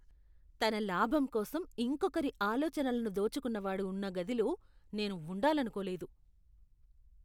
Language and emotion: Telugu, disgusted